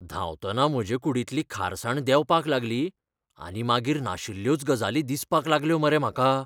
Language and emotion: Goan Konkani, fearful